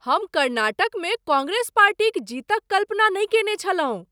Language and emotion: Maithili, surprised